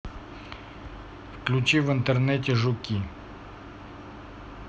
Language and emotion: Russian, neutral